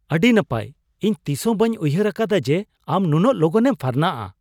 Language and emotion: Santali, surprised